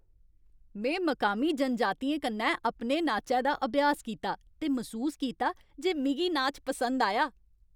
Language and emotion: Dogri, happy